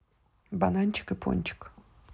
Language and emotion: Russian, neutral